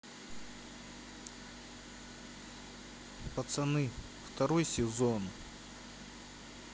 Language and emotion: Russian, sad